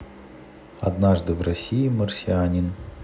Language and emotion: Russian, neutral